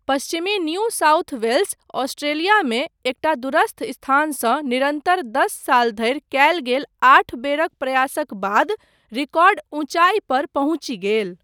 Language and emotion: Maithili, neutral